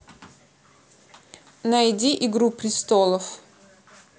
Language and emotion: Russian, neutral